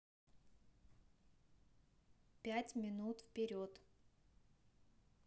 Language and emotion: Russian, neutral